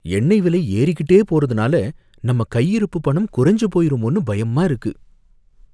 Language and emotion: Tamil, fearful